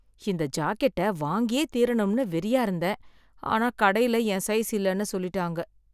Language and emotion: Tamil, sad